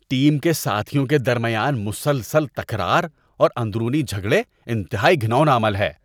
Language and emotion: Urdu, disgusted